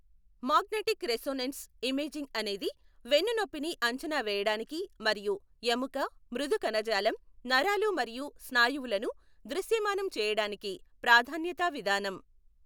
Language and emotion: Telugu, neutral